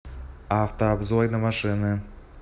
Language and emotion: Russian, neutral